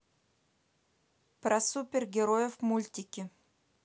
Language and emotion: Russian, neutral